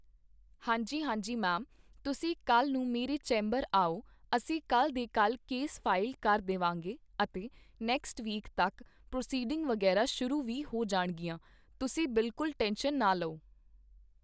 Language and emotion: Punjabi, neutral